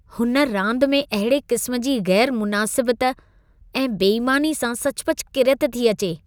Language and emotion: Sindhi, disgusted